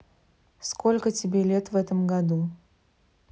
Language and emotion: Russian, neutral